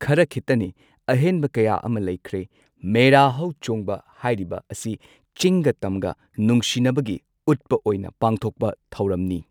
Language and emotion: Manipuri, neutral